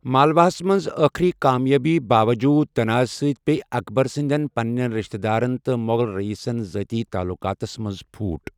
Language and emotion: Kashmiri, neutral